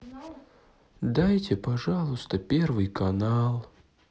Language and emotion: Russian, sad